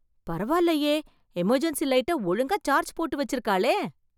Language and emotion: Tamil, surprised